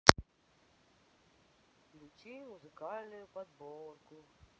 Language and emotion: Russian, neutral